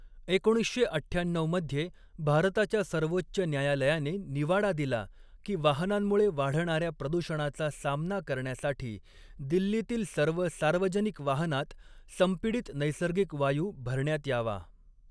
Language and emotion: Marathi, neutral